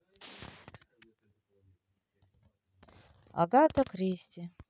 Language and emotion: Russian, sad